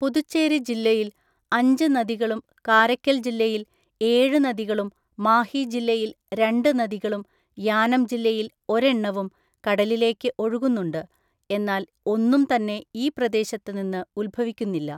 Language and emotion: Malayalam, neutral